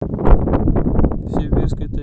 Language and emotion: Russian, neutral